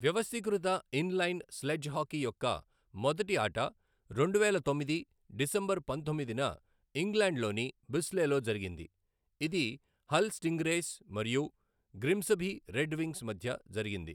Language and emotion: Telugu, neutral